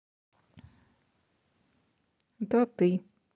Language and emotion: Russian, neutral